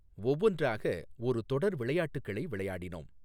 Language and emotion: Tamil, neutral